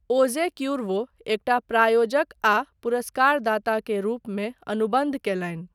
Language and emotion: Maithili, neutral